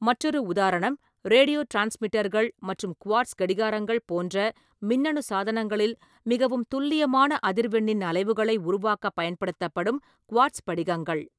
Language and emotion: Tamil, neutral